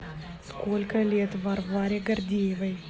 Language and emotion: Russian, neutral